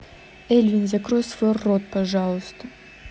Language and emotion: Russian, angry